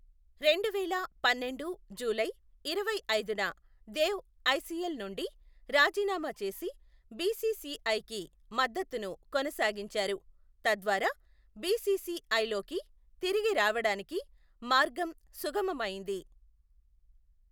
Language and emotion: Telugu, neutral